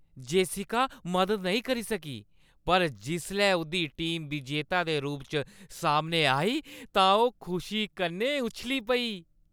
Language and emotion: Dogri, happy